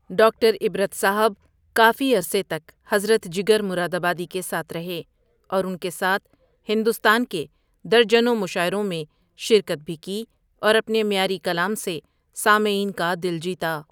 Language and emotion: Urdu, neutral